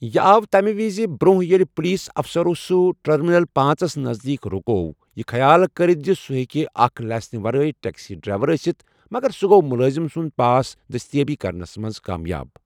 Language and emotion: Kashmiri, neutral